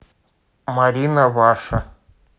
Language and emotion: Russian, neutral